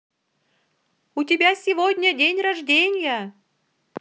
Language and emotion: Russian, positive